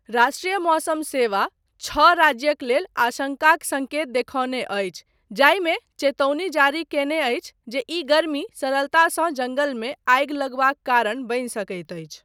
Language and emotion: Maithili, neutral